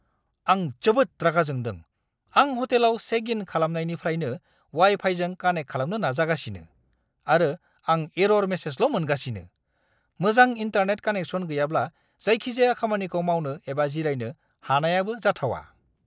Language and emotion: Bodo, angry